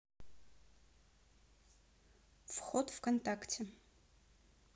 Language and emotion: Russian, neutral